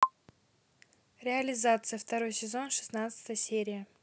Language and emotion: Russian, neutral